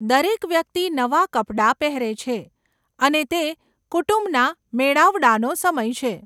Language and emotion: Gujarati, neutral